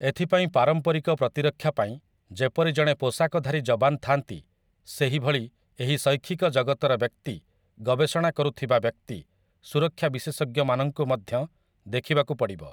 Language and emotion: Odia, neutral